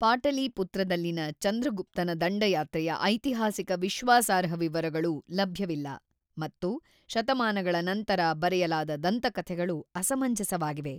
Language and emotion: Kannada, neutral